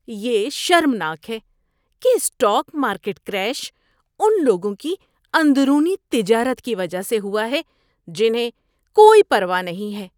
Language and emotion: Urdu, disgusted